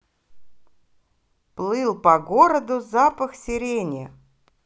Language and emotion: Russian, positive